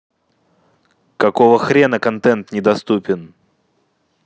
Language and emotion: Russian, angry